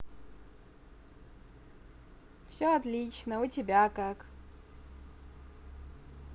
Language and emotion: Russian, positive